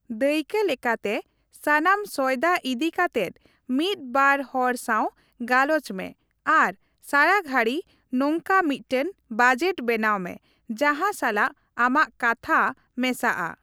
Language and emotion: Santali, neutral